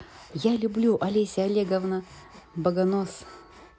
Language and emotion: Russian, positive